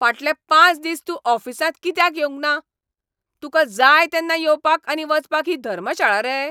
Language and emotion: Goan Konkani, angry